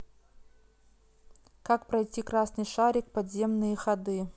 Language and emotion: Russian, neutral